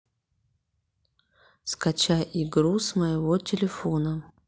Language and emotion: Russian, neutral